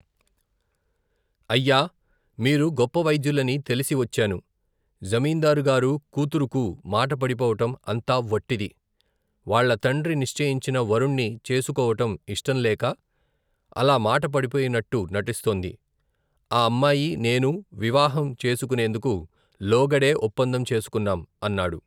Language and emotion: Telugu, neutral